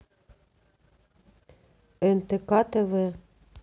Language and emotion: Russian, neutral